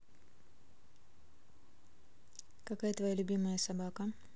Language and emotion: Russian, neutral